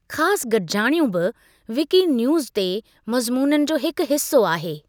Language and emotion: Sindhi, neutral